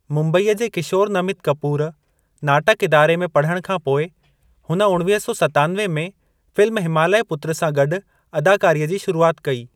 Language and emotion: Sindhi, neutral